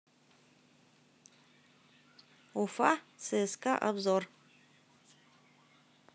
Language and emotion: Russian, neutral